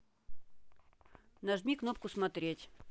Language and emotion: Russian, neutral